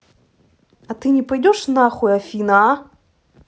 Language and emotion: Russian, angry